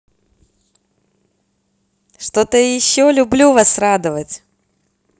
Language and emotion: Russian, positive